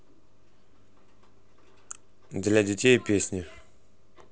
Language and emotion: Russian, neutral